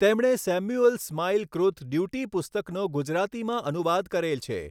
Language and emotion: Gujarati, neutral